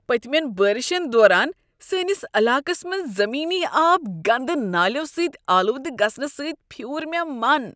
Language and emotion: Kashmiri, disgusted